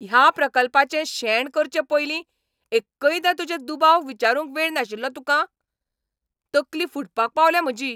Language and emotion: Goan Konkani, angry